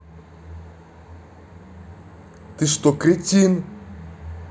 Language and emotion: Russian, angry